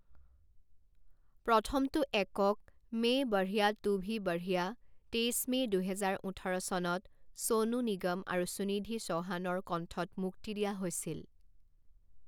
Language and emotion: Assamese, neutral